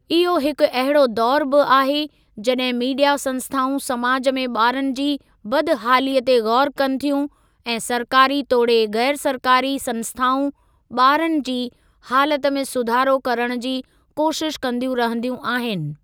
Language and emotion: Sindhi, neutral